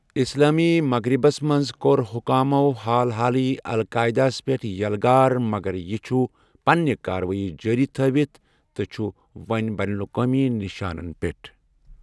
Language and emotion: Kashmiri, neutral